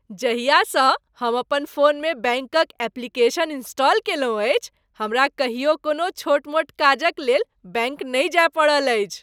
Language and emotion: Maithili, happy